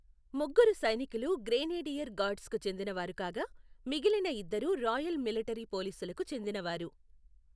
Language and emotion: Telugu, neutral